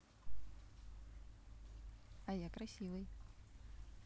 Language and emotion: Russian, positive